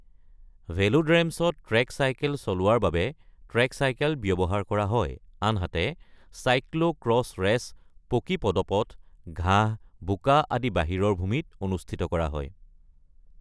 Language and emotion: Assamese, neutral